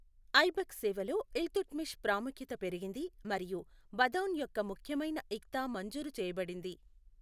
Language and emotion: Telugu, neutral